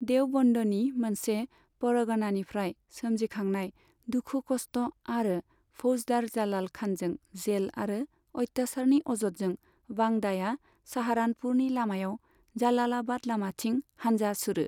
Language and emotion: Bodo, neutral